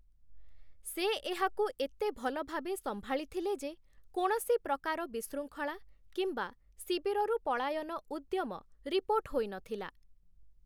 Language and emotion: Odia, neutral